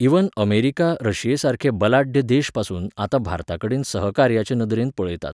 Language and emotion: Goan Konkani, neutral